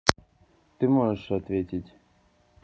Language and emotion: Russian, neutral